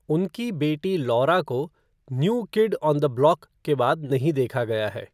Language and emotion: Hindi, neutral